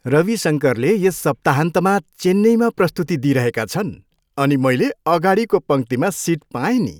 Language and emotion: Nepali, happy